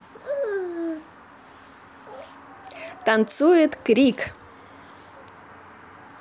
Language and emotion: Russian, positive